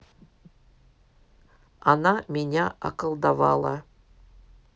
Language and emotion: Russian, neutral